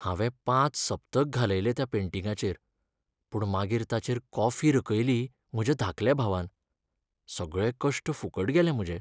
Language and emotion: Goan Konkani, sad